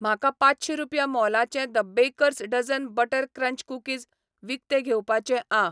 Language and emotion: Goan Konkani, neutral